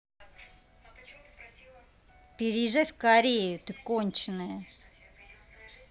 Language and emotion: Russian, angry